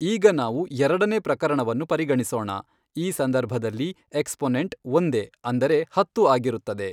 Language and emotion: Kannada, neutral